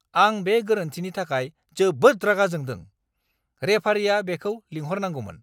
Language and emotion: Bodo, angry